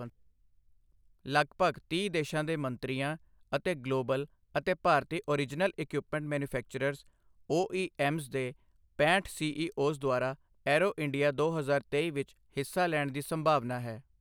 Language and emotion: Punjabi, neutral